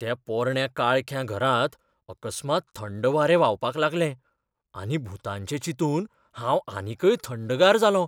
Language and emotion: Goan Konkani, fearful